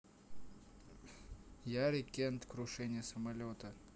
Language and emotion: Russian, neutral